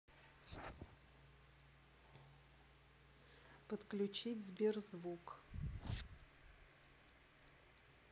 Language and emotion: Russian, neutral